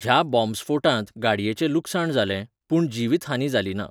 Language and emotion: Goan Konkani, neutral